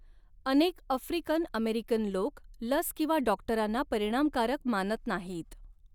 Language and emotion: Marathi, neutral